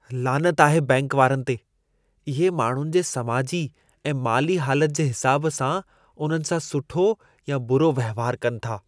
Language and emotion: Sindhi, disgusted